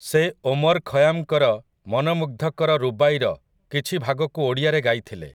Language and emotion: Odia, neutral